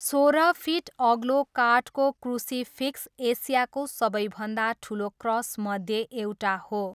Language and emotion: Nepali, neutral